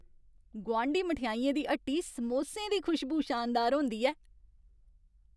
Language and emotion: Dogri, happy